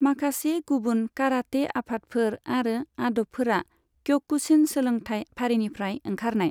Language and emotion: Bodo, neutral